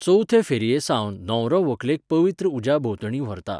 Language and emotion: Goan Konkani, neutral